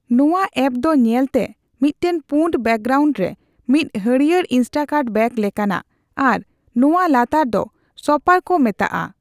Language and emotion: Santali, neutral